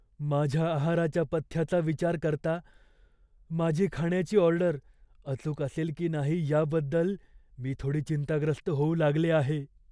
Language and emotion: Marathi, fearful